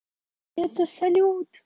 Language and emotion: Russian, positive